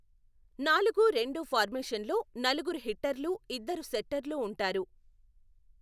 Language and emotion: Telugu, neutral